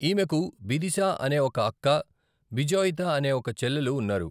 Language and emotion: Telugu, neutral